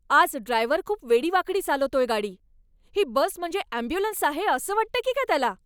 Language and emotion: Marathi, angry